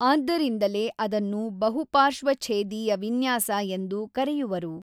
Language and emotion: Kannada, neutral